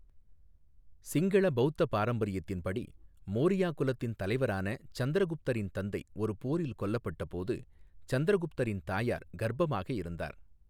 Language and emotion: Tamil, neutral